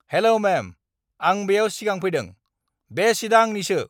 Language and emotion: Bodo, angry